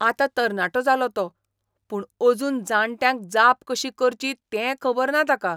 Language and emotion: Goan Konkani, disgusted